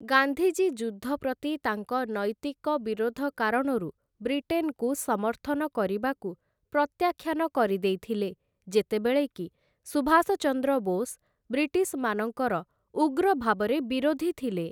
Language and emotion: Odia, neutral